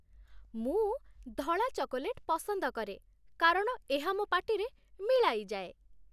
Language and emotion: Odia, happy